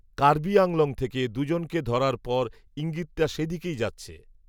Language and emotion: Bengali, neutral